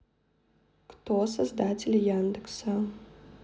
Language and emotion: Russian, neutral